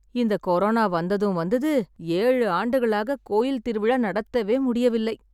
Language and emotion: Tamil, sad